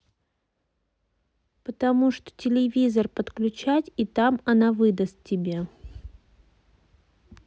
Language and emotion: Russian, neutral